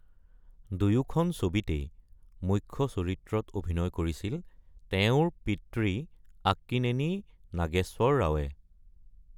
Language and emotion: Assamese, neutral